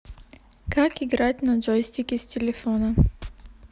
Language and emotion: Russian, neutral